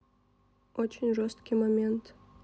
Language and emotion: Russian, neutral